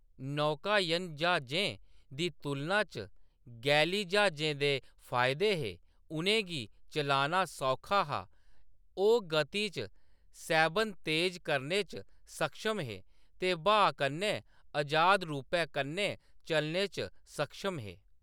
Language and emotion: Dogri, neutral